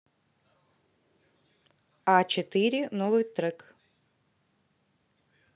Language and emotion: Russian, neutral